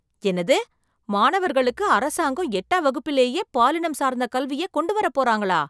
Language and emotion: Tamil, surprised